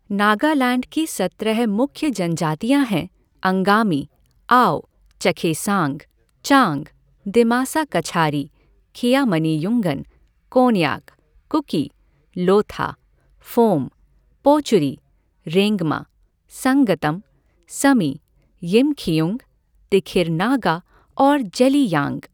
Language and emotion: Hindi, neutral